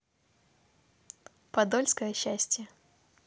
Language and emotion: Russian, positive